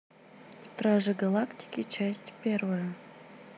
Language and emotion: Russian, neutral